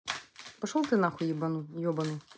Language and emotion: Russian, angry